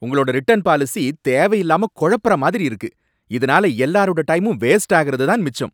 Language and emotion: Tamil, angry